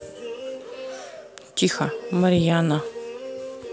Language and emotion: Russian, neutral